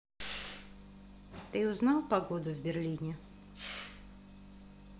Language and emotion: Russian, neutral